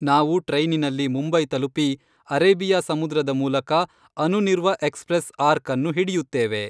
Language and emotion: Kannada, neutral